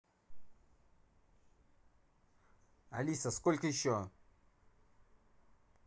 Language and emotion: Russian, angry